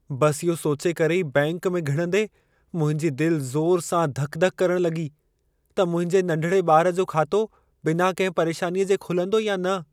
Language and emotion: Sindhi, fearful